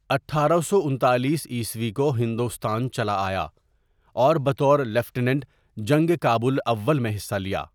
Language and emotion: Urdu, neutral